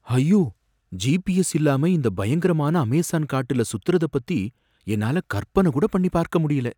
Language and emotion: Tamil, fearful